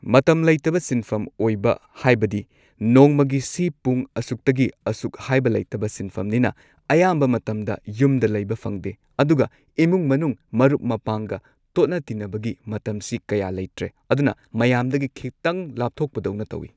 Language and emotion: Manipuri, neutral